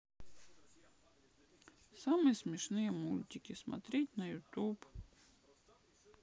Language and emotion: Russian, sad